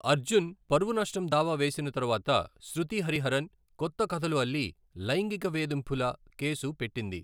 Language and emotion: Telugu, neutral